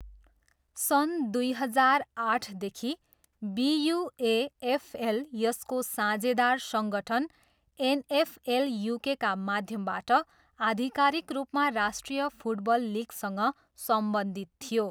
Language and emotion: Nepali, neutral